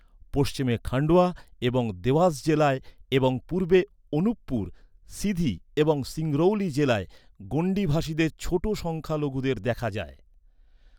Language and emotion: Bengali, neutral